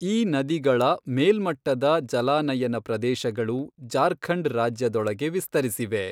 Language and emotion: Kannada, neutral